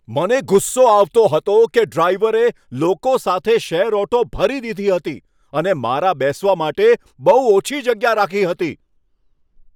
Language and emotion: Gujarati, angry